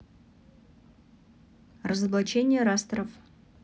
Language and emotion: Russian, neutral